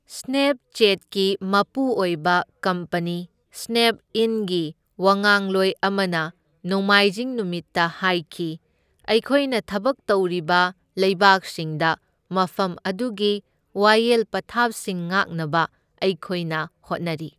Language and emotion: Manipuri, neutral